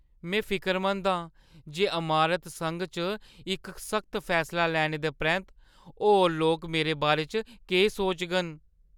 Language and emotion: Dogri, fearful